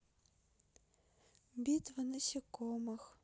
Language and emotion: Russian, sad